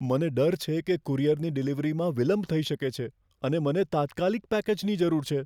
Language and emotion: Gujarati, fearful